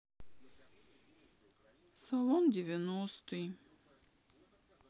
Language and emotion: Russian, sad